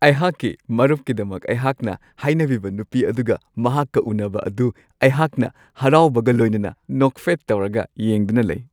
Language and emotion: Manipuri, happy